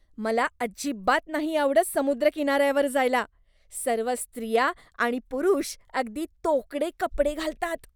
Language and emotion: Marathi, disgusted